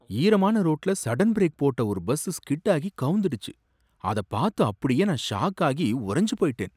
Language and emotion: Tamil, surprised